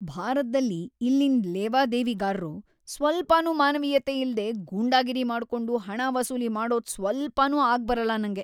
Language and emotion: Kannada, disgusted